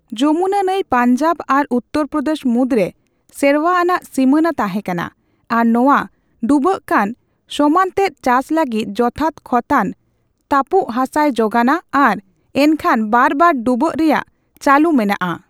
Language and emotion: Santali, neutral